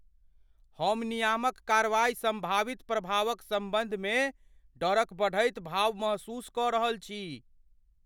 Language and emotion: Maithili, fearful